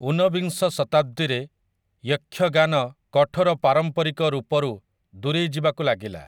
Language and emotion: Odia, neutral